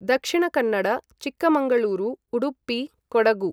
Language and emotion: Sanskrit, neutral